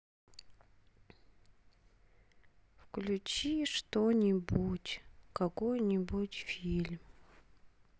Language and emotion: Russian, sad